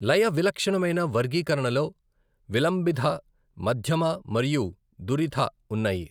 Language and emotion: Telugu, neutral